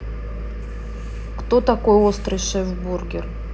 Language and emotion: Russian, neutral